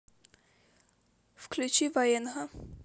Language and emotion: Russian, sad